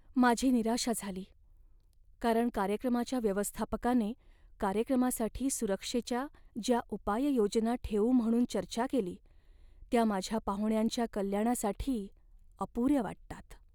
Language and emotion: Marathi, sad